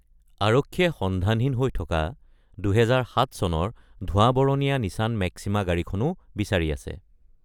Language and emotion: Assamese, neutral